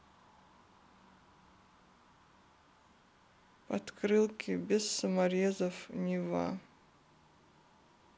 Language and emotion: Russian, sad